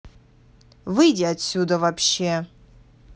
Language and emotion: Russian, angry